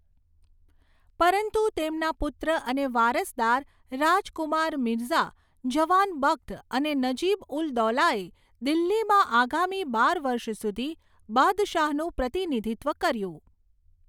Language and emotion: Gujarati, neutral